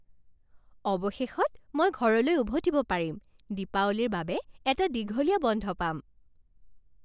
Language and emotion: Assamese, happy